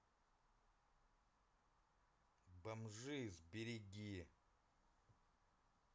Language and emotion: Russian, neutral